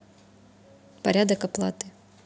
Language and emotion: Russian, neutral